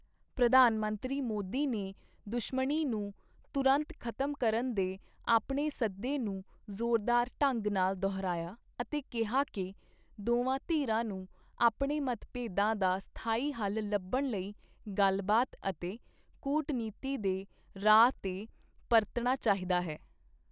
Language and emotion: Punjabi, neutral